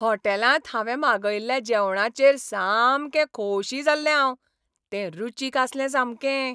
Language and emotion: Goan Konkani, happy